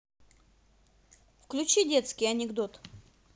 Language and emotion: Russian, positive